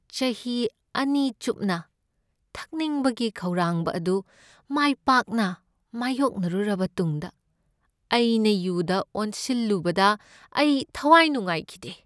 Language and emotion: Manipuri, sad